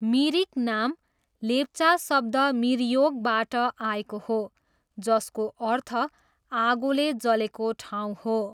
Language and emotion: Nepali, neutral